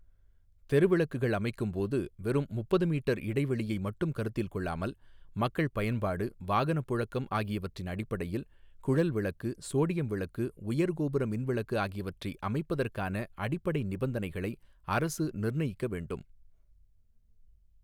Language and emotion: Tamil, neutral